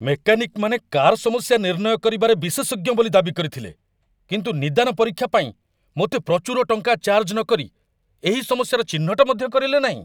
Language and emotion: Odia, angry